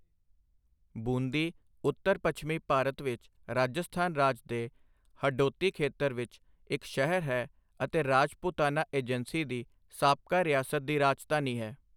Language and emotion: Punjabi, neutral